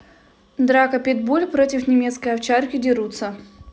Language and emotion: Russian, neutral